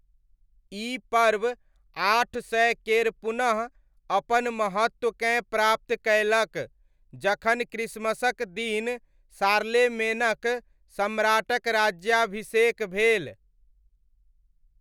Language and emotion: Maithili, neutral